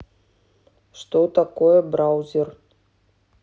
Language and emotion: Russian, neutral